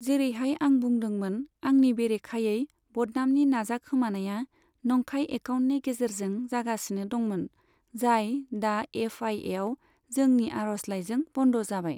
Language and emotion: Bodo, neutral